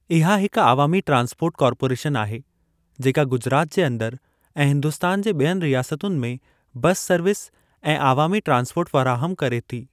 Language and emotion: Sindhi, neutral